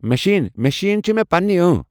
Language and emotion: Kashmiri, neutral